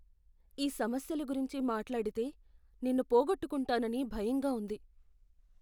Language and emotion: Telugu, fearful